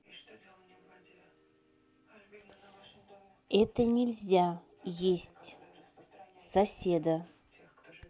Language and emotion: Russian, neutral